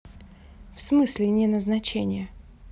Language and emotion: Russian, neutral